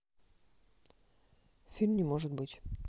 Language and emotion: Russian, neutral